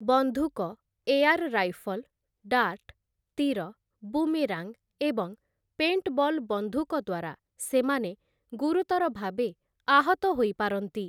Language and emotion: Odia, neutral